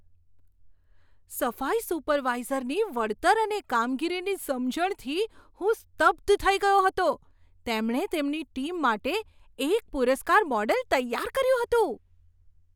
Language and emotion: Gujarati, surprised